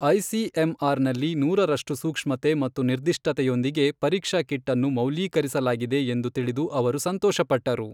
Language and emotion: Kannada, neutral